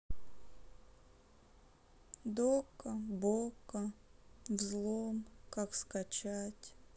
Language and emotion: Russian, sad